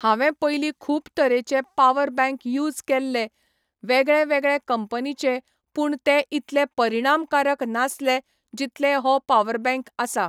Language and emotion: Goan Konkani, neutral